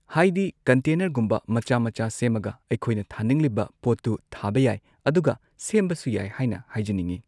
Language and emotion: Manipuri, neutral